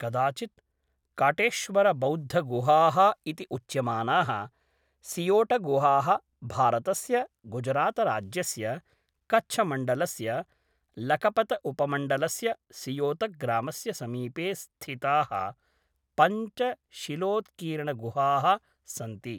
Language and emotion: Sanskrit, neutral